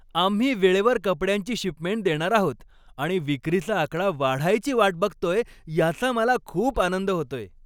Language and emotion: Marathi, happy